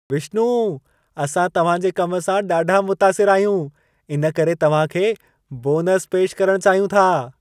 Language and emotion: Sindhi, happy